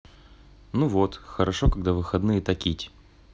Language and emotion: Russian, neutral